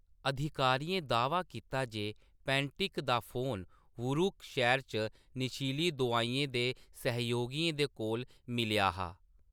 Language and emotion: Dogri, neutral